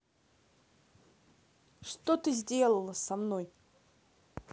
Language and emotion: Russian, angry